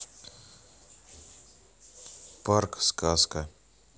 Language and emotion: Russian, neutral